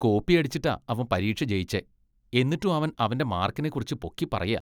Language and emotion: Malayalam, disgusted